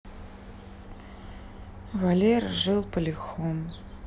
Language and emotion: Russian, sad